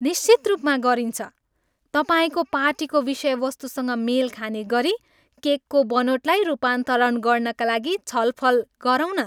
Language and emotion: Nepali, happy